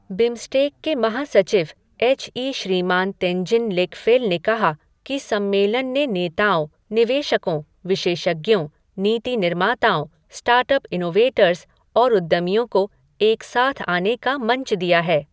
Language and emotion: Hindi, neutral